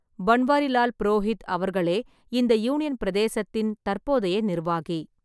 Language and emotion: Tamil, neutral